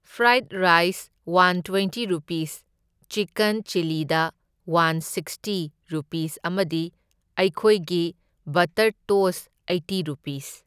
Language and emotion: Manipuri, neutral